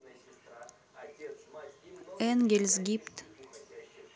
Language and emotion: Russian, neutral